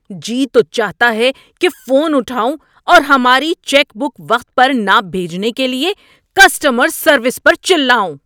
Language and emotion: Urdu, angry